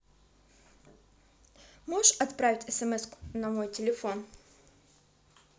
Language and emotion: Russian, neutral